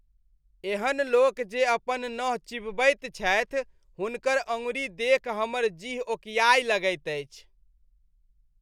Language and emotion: Maithili, disgusted